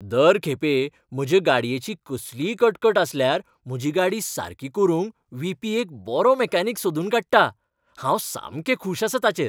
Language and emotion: Goan Konkani, happy